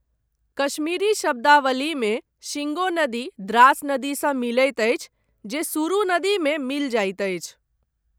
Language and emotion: Maithili, neutral